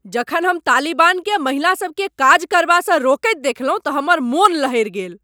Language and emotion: Maithili, angry